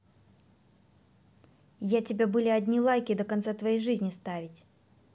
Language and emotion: Russian, angry